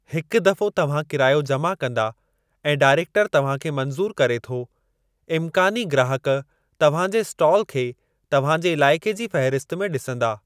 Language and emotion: Sindhi, neutral